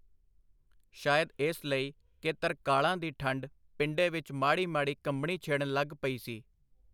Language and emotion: Punjabi, neutral